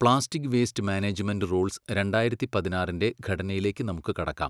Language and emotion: Malayalam, neutral